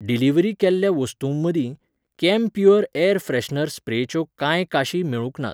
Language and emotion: Goan Konkani, neutral